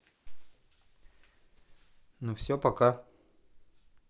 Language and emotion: Russian, neutral